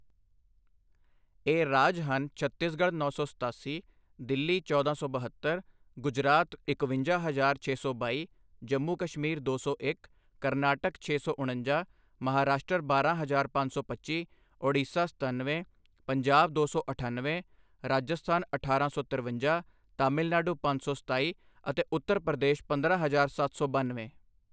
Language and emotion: Punjabi, neutral